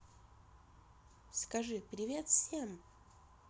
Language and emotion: Russian, positive